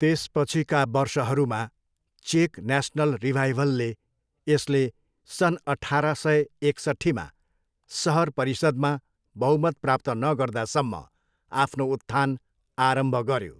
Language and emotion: Nepali, neutral